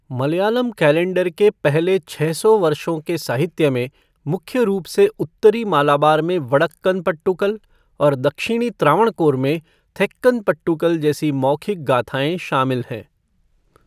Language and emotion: Hindi, neutral